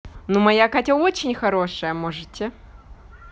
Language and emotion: Russian, positive